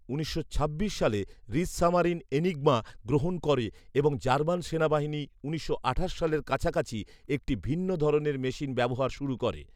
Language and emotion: Bengali, neutral